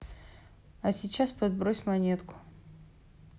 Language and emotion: Russian, neutral